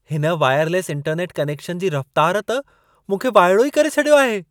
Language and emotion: Sindhi, surprised